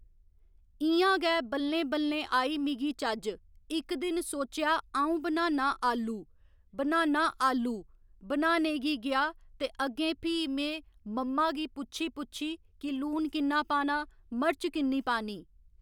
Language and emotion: Dogri, neutral